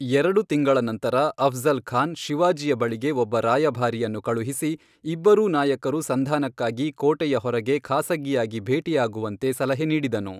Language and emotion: Kannada, neutral